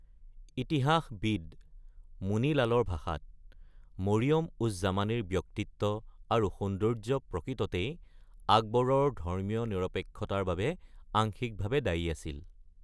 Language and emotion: Assamese, neutral